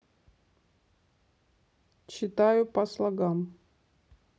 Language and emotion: Russian, neutral